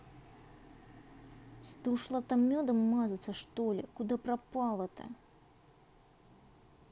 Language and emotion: Russian, angry